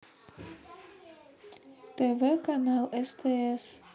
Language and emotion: Russian, neutral